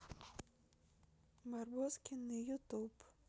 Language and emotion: Russian, neutral